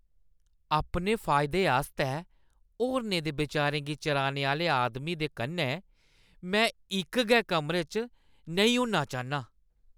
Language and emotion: Dogri, disgusted